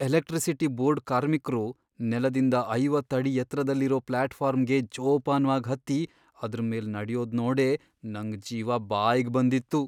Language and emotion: Kannada, fearful